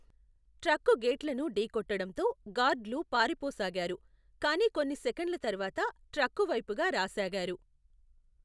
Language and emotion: Telugu, neutral